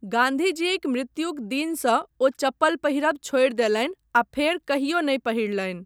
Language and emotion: Maithili, neutral